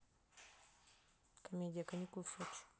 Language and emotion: Russian, neutral